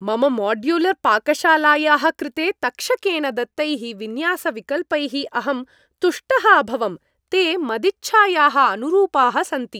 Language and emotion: Sanskrit, happy